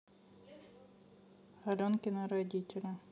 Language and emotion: Russian, neutral